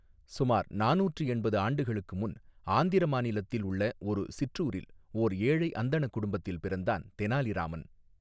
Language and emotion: Tamil, neutral